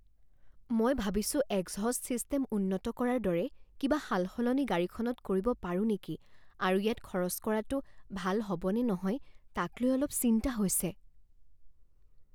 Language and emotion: Assamese, fearful